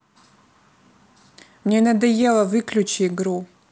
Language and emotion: Russian, angry